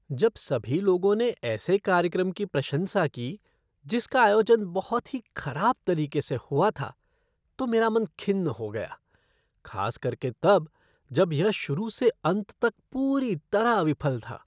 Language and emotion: Hindi, disgusted